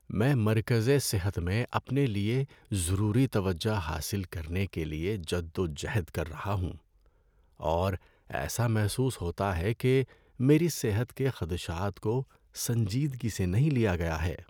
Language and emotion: Urdu, sad